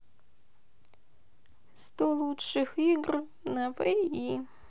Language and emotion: Russian, sad